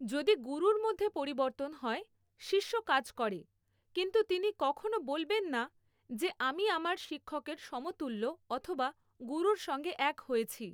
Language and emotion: Bengali, neutral